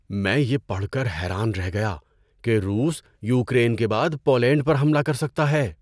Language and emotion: Urdu, surprised